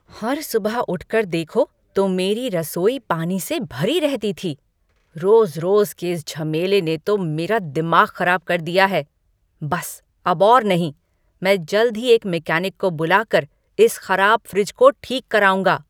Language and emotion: Hindi, angry